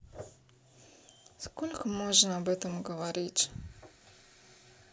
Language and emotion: Russian, sad